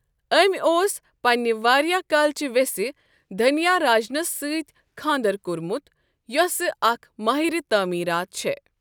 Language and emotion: Kashmiri, neutral